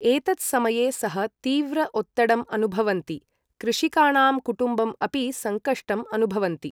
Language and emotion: Sanskrit, neutral